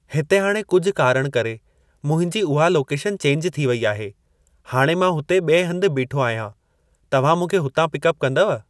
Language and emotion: Sindhi, neutral